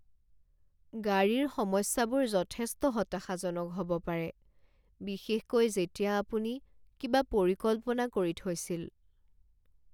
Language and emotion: Assamese, sad